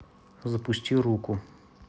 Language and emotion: Russian, neutral